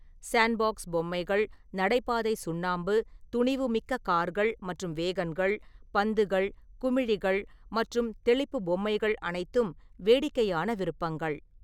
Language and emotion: Tamil, neutral